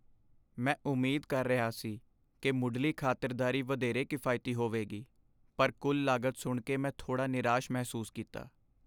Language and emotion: Punjabi, sad